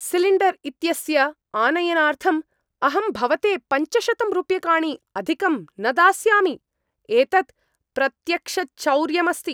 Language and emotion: Sanskrit, angry